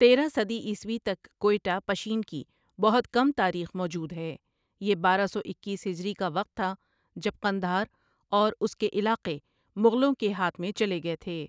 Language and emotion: Urdu, neutral